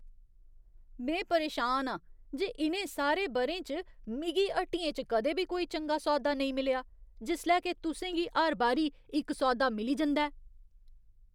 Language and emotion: Dogri, disgusted